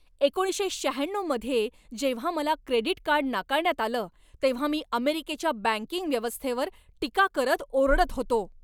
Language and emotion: Marathi, angry